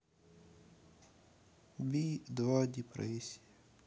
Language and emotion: Russian, sad